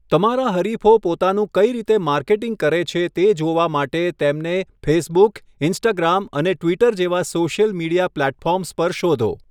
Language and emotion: Gujarati, neutral